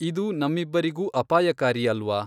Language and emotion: Kannada, neutral